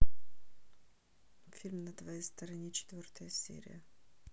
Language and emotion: Russian, neutral